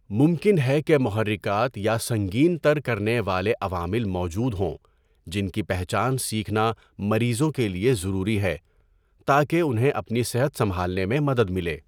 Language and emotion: Urdu, neutral